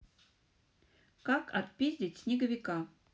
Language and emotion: Russian, neutral